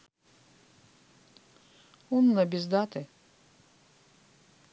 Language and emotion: Russian, neutral